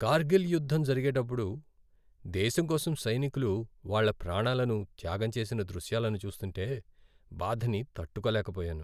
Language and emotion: Telugu, sad